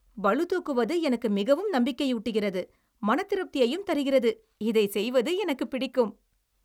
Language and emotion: Tamil, happy